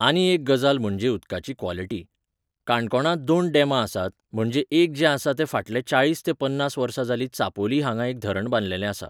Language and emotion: Goan Konkani, neutral